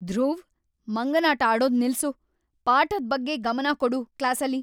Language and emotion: Kannada, angry